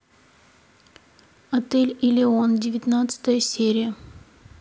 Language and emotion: Russian, neutral